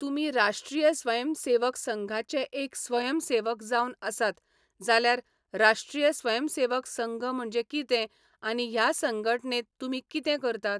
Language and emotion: Goan Konkani, neutral